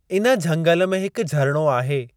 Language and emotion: Sindhi, neutral